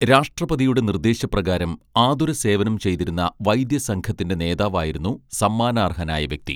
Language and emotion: Malayalam, neutral